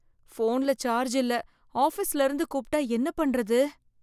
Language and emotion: Tamil, fearful